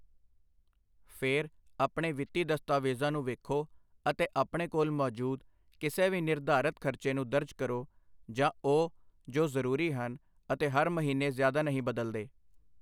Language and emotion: Punjabi, neutral